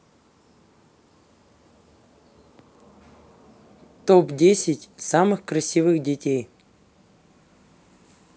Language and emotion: Russian, neutral